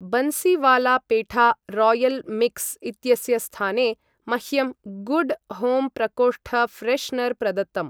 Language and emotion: Sanskrit, neutral